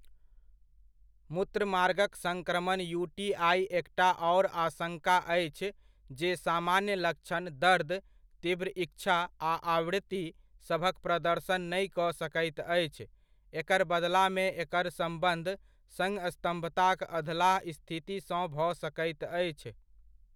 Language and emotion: Maithili, neutral